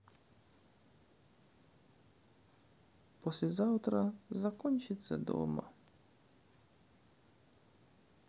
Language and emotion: Russian, sad